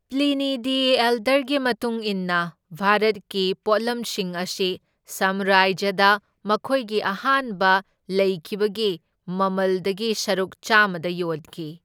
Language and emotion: Manipuri, neutral